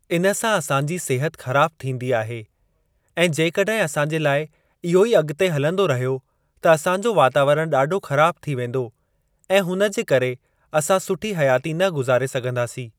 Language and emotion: Sindhi, neutral